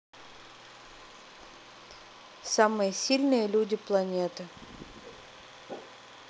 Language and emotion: Russian, neutral